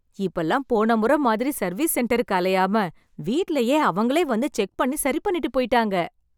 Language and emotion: Tamil, happy